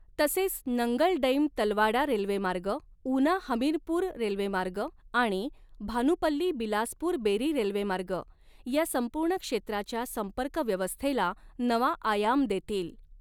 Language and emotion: Marathi, neutral